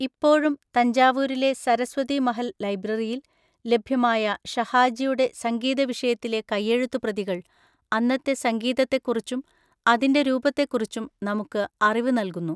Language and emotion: Malayalam, neutral